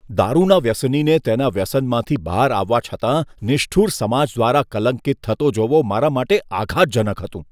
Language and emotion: Gujarati, disgusted